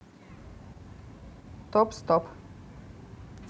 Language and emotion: Russian, neutral